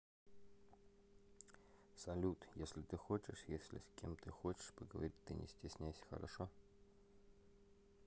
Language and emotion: Russian, neutral